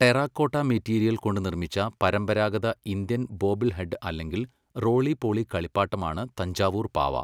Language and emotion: Malayalam, neutral